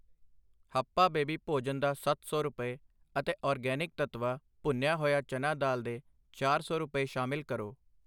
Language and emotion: Punjabi, neutral